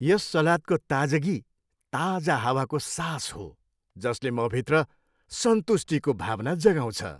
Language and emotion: Nepali, happy